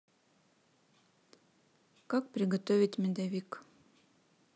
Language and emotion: Russian, neutral